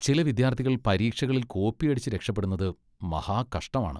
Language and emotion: Malayalam, disgusted